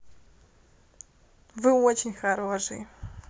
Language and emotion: Russian, positive